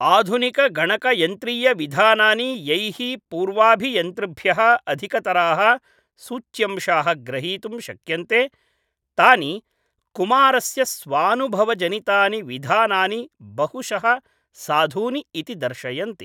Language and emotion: Sanskrit, neutral